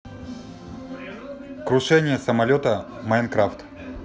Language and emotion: Russian, neutral